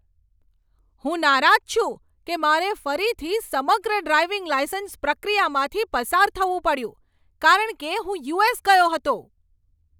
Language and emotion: Gujarati, angry